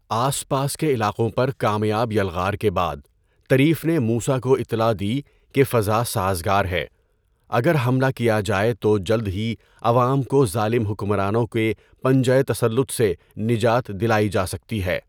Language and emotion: Urdu, neutral